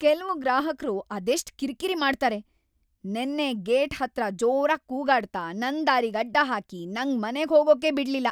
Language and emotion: Kannada, angry